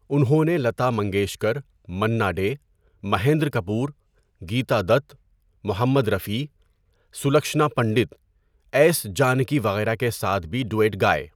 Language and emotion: Urdu, neutral